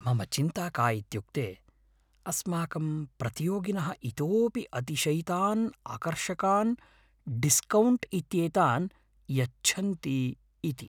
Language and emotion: Sanskrit, fearful